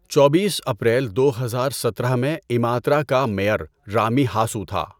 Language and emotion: Urdu, neutral